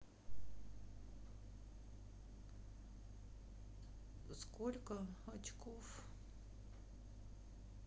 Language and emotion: Russian, sad